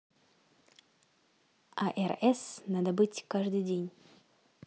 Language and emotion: Russian, neutral